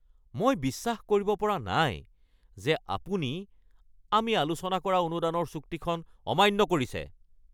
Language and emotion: Assamese, angry